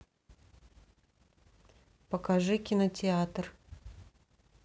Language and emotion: Russian, neutral